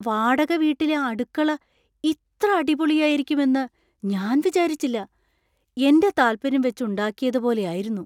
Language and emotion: Malayalam, surprised